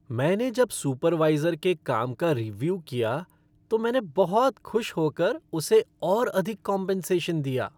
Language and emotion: Hindi, happy